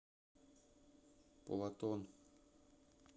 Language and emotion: Russian, neutral